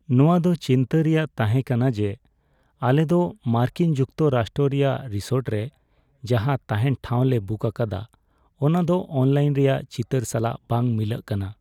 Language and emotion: Santali, sad